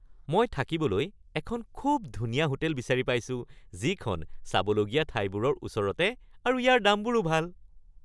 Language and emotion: Assamese, happy